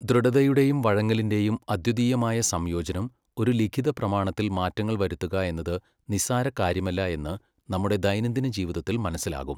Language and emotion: Malayalam, neutral